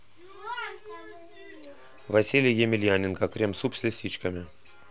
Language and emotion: Russian, neutral